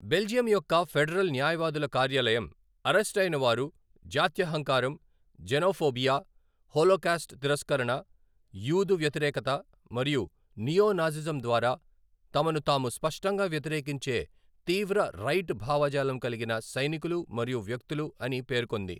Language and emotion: Telugu, neutral